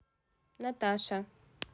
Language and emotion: Russian, neutral